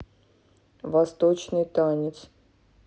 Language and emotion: Russian, neutral